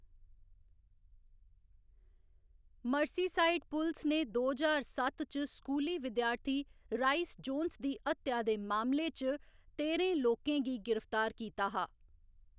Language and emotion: Dogri, neutral